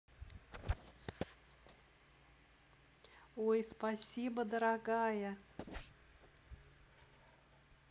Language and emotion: Russian, positive